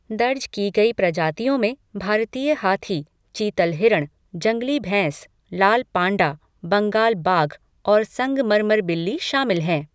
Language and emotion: Hindi, neutral